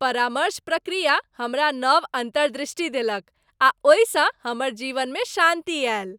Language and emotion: Maithili, happy